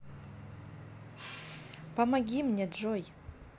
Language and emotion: Russian, neutral